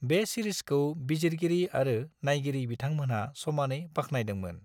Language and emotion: Bodo, neutral